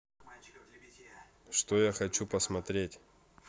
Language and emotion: Russian, neutral